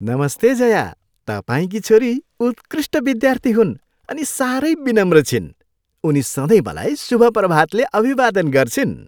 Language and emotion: Nepali, happy